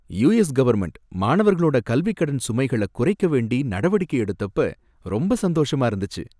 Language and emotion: Tamil, happy